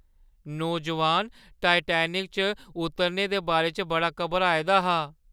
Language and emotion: Dogri, fearful